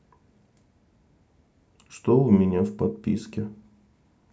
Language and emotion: Russian, neutral